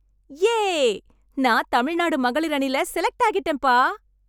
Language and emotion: Tamil, happy